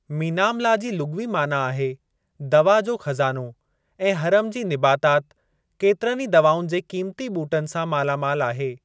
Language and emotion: Sindhi, neutral